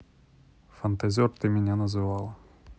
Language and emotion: Russian, neutral